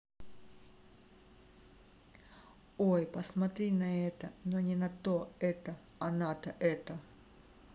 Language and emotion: Russian, neutral